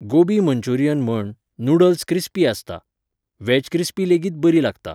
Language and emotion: Goan Konkani, neutral